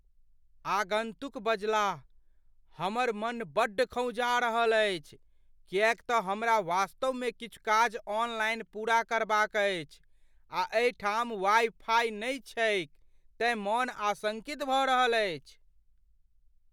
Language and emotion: Maithili, fearful